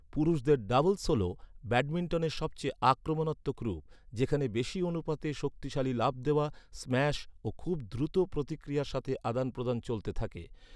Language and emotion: Bengali, neutral